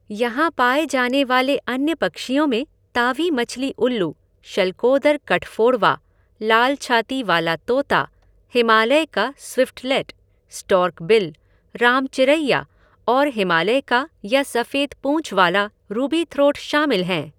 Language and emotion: Hindi, neutral